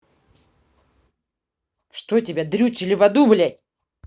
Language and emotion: Russian, angry